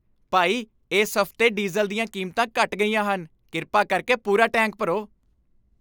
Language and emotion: Punjabi, happy